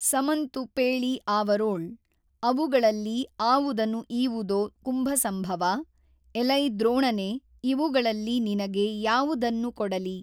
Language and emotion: Kannada, neutral